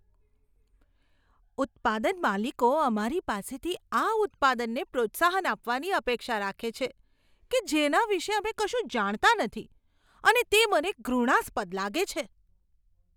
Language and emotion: Gujarati, disgusted